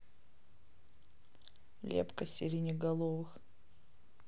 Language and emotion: Russian, neutral